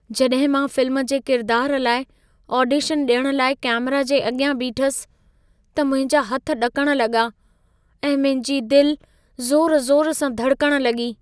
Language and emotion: Sindhi, fearful